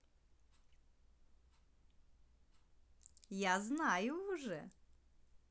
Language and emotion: Russian, positive